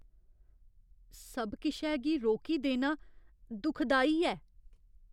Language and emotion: Dogri, fearful